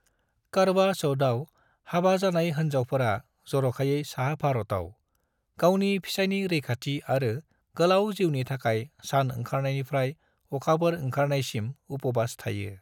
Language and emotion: Bodo, neutral